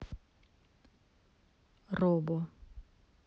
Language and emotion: Russian, neutral